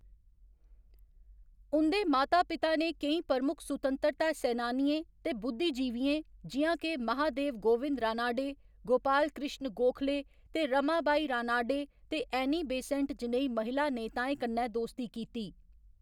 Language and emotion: Dogri, neutral